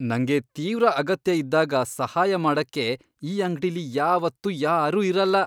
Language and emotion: Kannada, disgusted